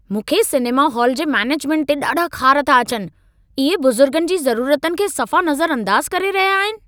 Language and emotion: Sindhi, angry